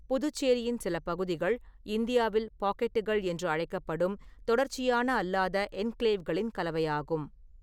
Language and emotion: Tamil, neutral